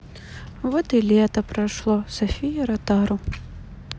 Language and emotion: Russian, sad